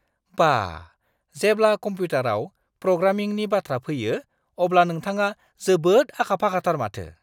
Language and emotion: Bodo, surprised